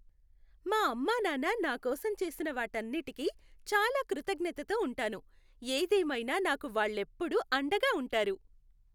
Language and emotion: Telugu, happy